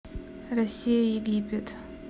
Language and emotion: Russian, neutral